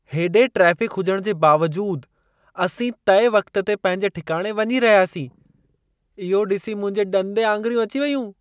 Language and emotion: Sindhi, surprised